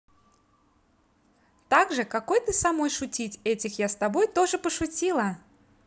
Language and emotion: Russian, positive